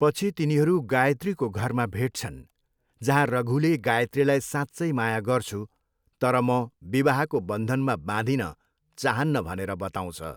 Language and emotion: Nepali, neutral